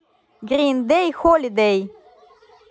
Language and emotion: Russian, positive